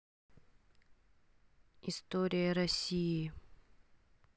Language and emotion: Russian, neutral